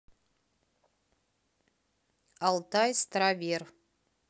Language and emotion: Russian, neutral